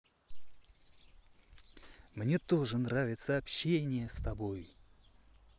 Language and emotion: Russian, positive